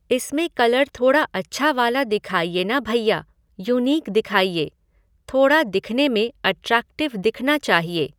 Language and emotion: Hindi, neutral